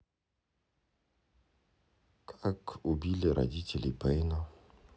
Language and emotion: Russian, sad